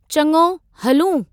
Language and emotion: Sindhi, neutral